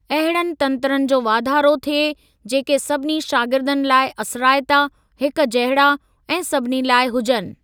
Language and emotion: Sindhi, neutral